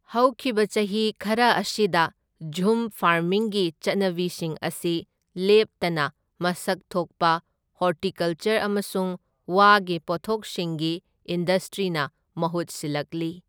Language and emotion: Manipuri, neutral